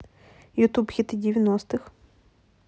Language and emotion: Russian, neutral